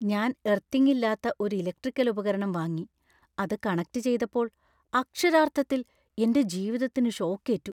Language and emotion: Malayalam, fearful